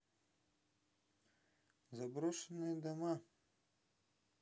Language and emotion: Russian, neutral